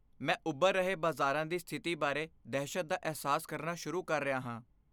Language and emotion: Punjabi, fearful